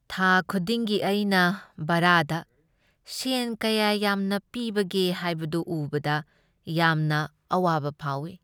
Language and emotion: Manipuri, sad